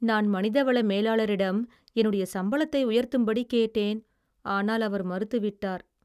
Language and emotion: Tamil, sad